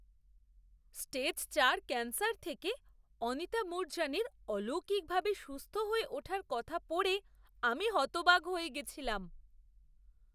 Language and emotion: Bengali, surprised